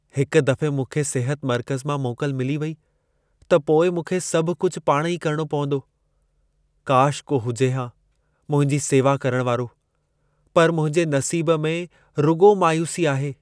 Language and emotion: Sindhi, sad